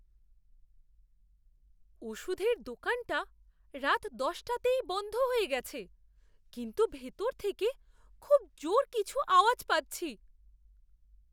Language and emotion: Bengali, fearful